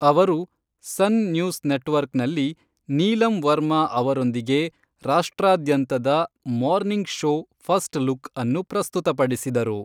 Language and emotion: Kannada, neutral